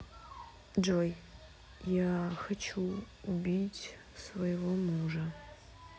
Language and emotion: Russian, neutral